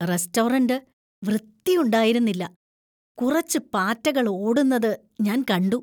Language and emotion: Malayalam, disgusted